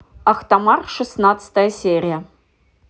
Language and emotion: Russian, neutral